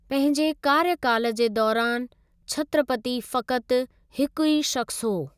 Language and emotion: Sindhi, neutral